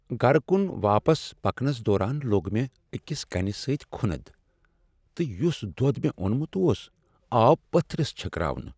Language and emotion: Kashmiri, sad